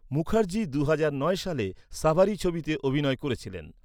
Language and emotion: Bengali, neutral